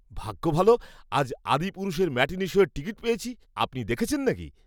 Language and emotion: Bengali, happy